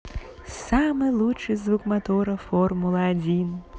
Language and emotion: Russian, positive